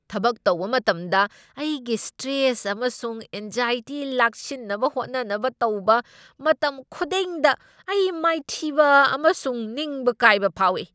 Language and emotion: Manipuri, angry